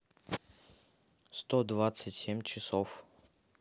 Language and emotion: Russian, neutral